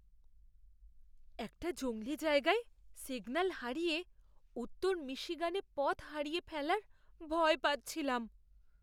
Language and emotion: Bengali, fearful